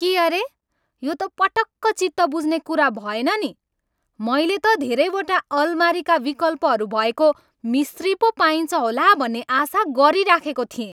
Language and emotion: Nepali, angry